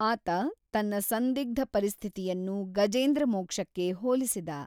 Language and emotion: Kannada, neutral